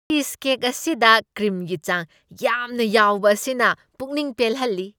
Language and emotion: Manipuri, happy